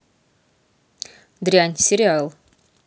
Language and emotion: Russian, neutral